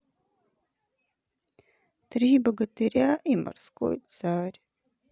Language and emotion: Russian, sad